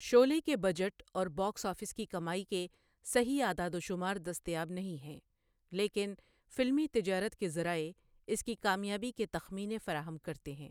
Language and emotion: Urdu, neutral